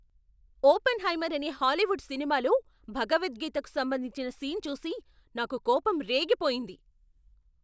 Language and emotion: Telugu, angry